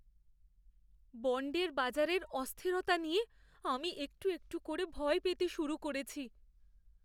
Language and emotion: Bengali, fearful